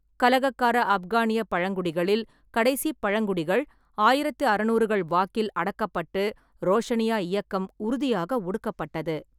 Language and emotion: Tamil, neutral